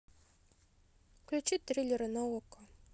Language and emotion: Russian, neutral